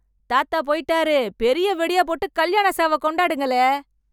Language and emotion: Tamil, happy